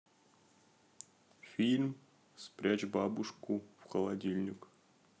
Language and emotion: Russian, neutral